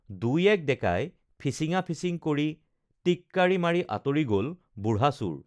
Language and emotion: Assamese, neutral